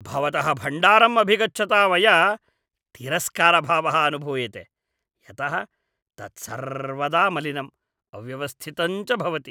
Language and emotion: Sanskrit, disgusted